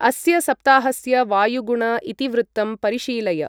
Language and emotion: Sanskrit, neutral